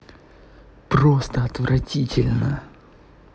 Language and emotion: Russian, angry